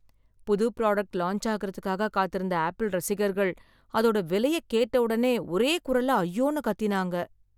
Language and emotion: Tamil, sad